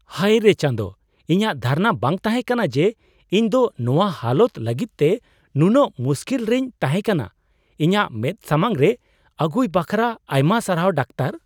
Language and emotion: Santali, surprised